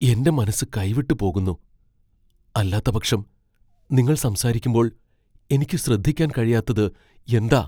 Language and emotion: Malayalam, fearful